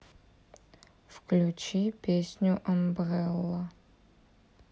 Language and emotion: Russian, sad